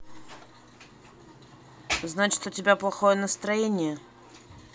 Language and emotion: Russian, neutral